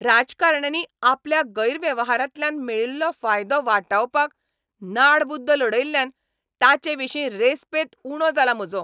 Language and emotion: Goan Konkani, angry